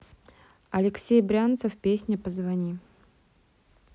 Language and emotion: Russian, neutral